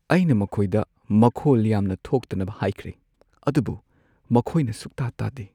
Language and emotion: Manipuri, sad